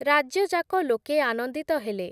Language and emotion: Odia, neutral